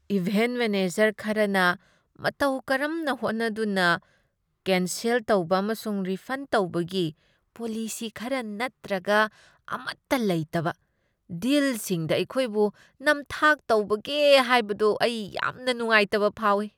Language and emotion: Manipuri, disgusted